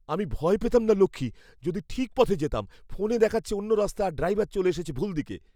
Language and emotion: Bengali, fearful